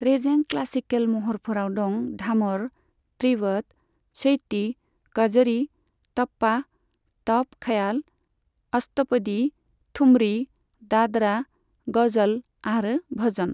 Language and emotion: Bodo, neutral